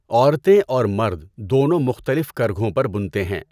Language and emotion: Urdu, neutral